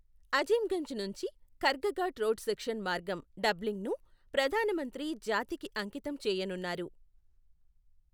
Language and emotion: Telugu, neutral